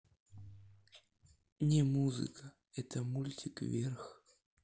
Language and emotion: Russian, sad